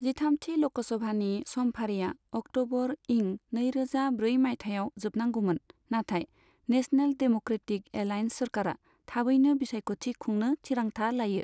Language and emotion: Bodo, neutral